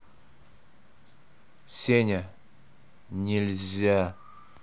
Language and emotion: Russian, angry